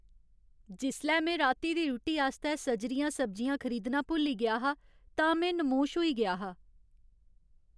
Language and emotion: Dogri, sad